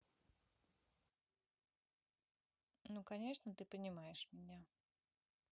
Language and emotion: Russian, neutral